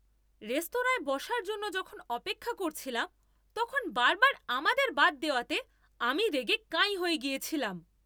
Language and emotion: Bengali, angry